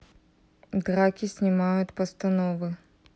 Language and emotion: Russian, neutral